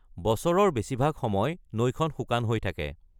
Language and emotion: Assamese, neutral